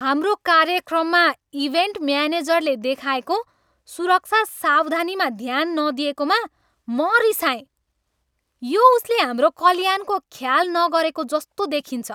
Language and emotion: Nepali, angry